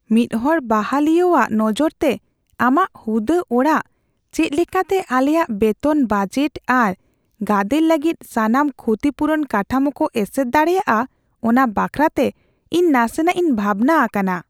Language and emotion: Santali, fearful